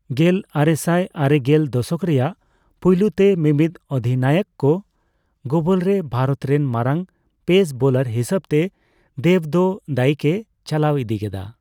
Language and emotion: Santali, neutral